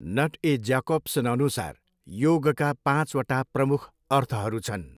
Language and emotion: Nepali, neutral